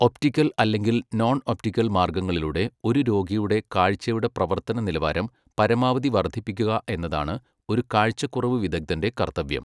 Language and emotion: Malayalam, neutral